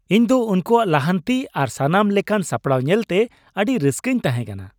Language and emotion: Santali, happy